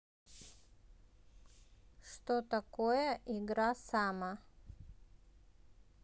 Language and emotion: Russian, neutral